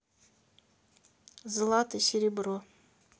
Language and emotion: Russian, neutral